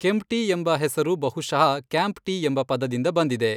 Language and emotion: Kannada, neutral